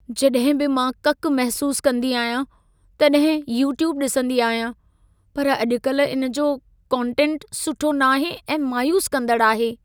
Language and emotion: Sindhi, sad